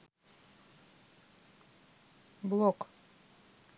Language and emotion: Russian, neutral